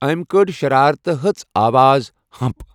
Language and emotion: Kashmiri, neutral